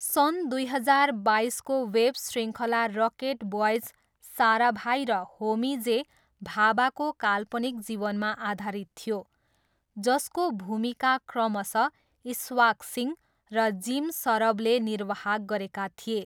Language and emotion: Nepali, neutral